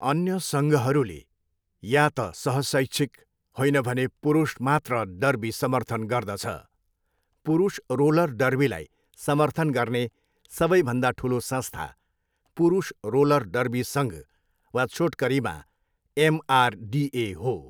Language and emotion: Nepali, neutral